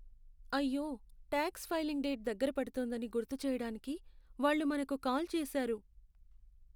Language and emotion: Telugu, sad